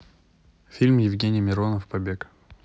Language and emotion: Russian, neutral